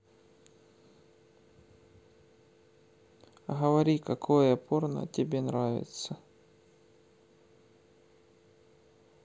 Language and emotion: Russian, neutral